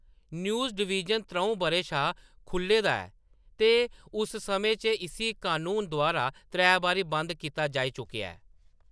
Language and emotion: Dogri, neutral